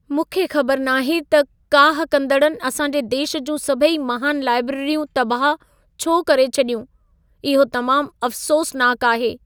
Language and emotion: Sindhi, sad